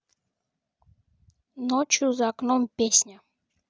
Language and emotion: Russian, neutral